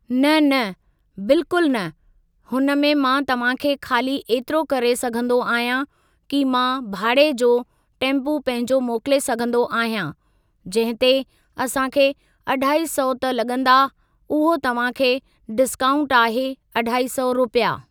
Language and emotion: Sindhi, neutral